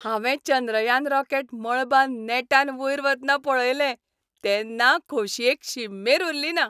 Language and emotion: Goan Konkani, happy